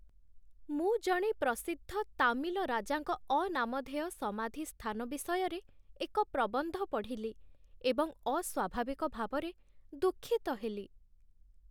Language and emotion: Odia, sad